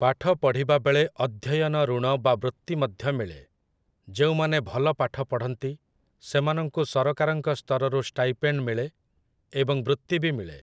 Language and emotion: Odia, neutral